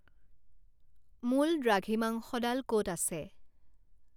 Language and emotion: Assamese, neutral